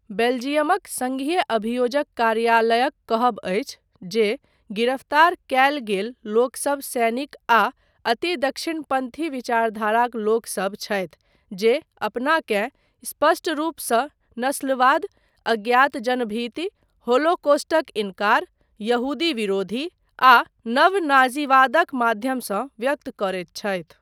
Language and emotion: Maithili, neutral